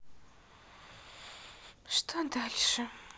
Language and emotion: Russian, sad